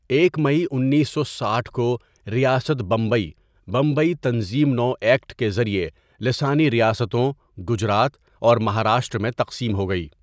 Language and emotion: Urdu, neutral